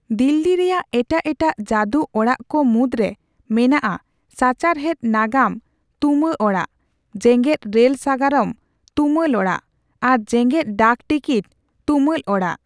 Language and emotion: Santali, neutral